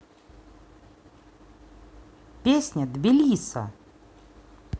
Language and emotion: Russian, positive